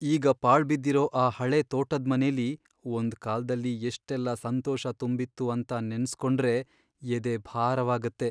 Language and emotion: Kannada, sad